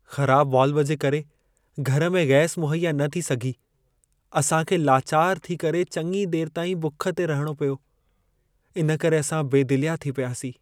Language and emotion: Sindhi, sad